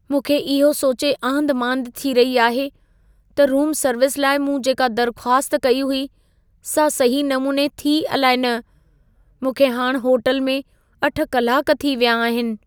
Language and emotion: Sindhi, fearful